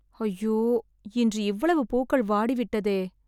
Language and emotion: Tamil, sad